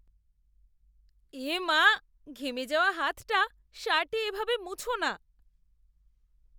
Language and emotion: Bengali, disgusted